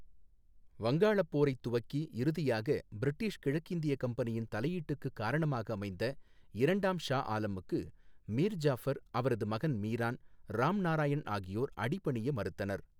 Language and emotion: Tamil, neutral